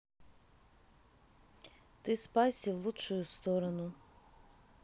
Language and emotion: Russian, neutral